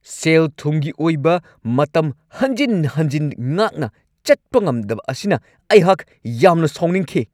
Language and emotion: Manipuri, angry